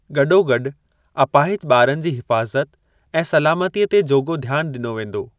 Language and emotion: Sindhi, neutral